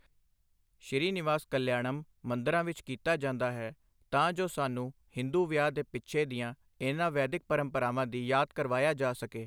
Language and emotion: Punjabi, neutral